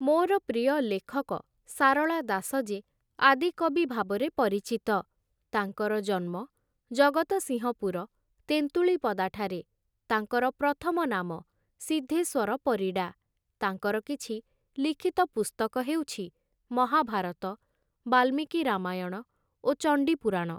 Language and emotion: Odia, neutral